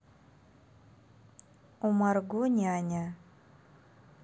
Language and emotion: Russian, neutral